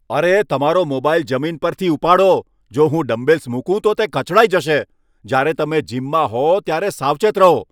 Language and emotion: Gujarati, angry